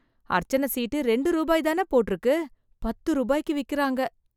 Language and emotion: Tamil, disgusted